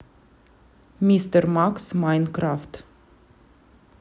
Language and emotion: Russian, neutral